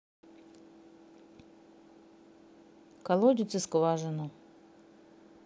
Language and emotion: Russian, neutral